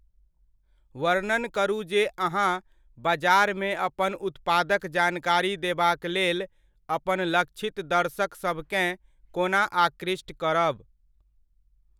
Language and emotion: Maithili, neutral